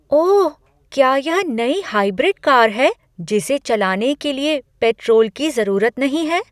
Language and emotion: Hindi, surprised